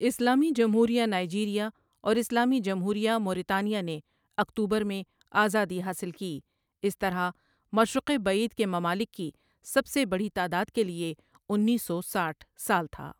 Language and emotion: Urdu, neutral